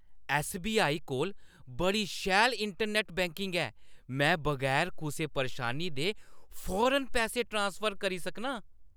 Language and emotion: Dogri, happy